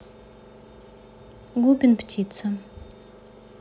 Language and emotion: Russian, neutral